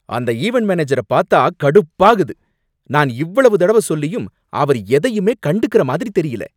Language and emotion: Tamil, angry